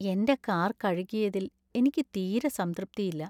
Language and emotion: Malayalam, sad